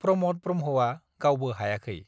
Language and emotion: Bodo, neutral